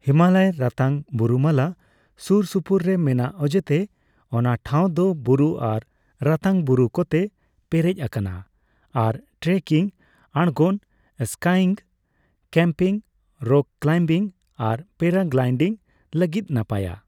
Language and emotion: Santali, neutral